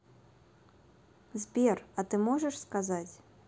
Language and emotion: Russian, neutral